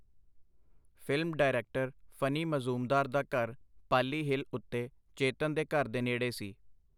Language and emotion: Punjabi, neutral